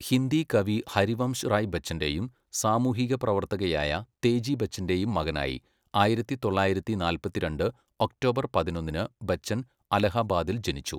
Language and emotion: Malayalam, neutral